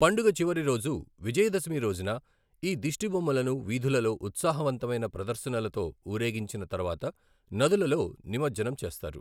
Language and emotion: Telugu, neutral